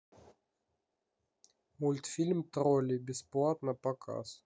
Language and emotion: Russian, neutral